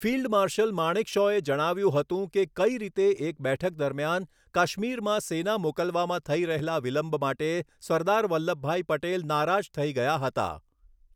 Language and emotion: Gujarati, neutral